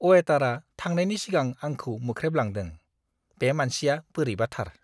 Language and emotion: Bodo, disgusted